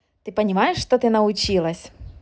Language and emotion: Russian, positive